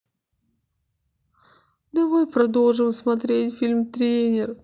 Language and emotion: Russian, sad